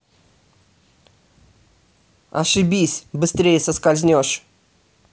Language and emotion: Russian, angry